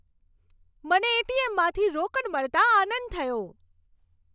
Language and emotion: Gujarati, happy